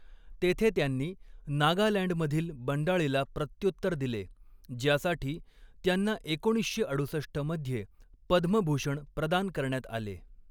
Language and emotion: Marathi, neutral